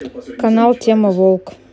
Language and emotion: Russian, neutral